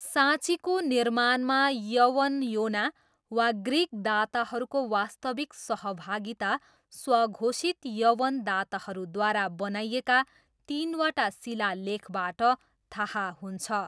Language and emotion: Nepali, neutral